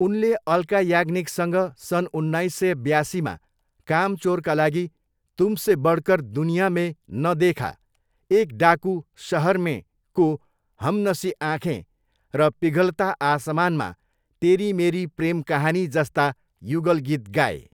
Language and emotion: Nepali, neutral